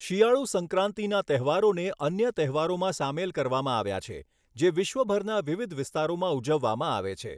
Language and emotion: Gujarati, neutral